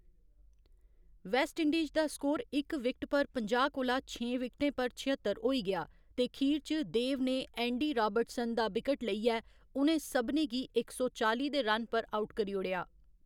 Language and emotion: Dogri, neutral